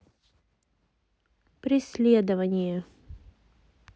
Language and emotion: Russian, neutral